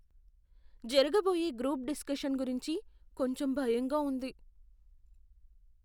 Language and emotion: Telugu, fearful